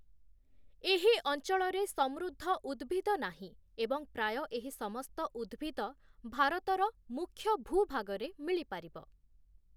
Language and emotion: Odia, neutral